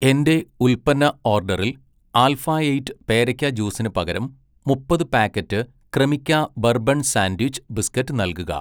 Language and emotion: Malayalam, neutral